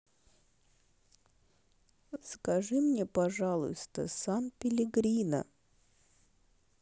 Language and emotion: Russian, neutral